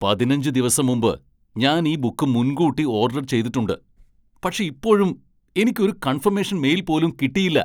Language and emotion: Malayalam, angry